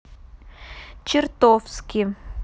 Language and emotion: Russian, neutral